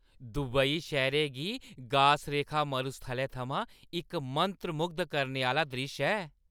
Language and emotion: Dogri, happy